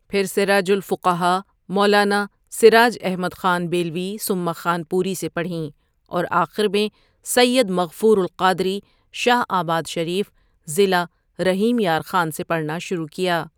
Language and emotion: Urdu, neutral